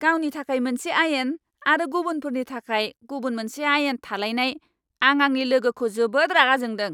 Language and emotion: Bodo, angry